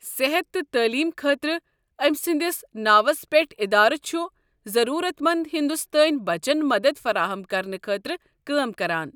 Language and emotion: Kashmiri, neutral